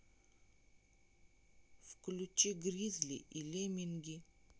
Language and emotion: Russian, neutral